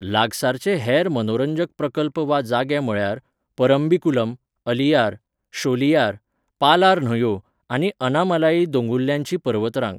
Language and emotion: Goan Konkani, neutral